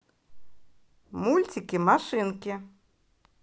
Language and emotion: Russian, positive